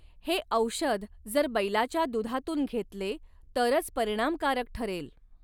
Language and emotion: Marathi, neutral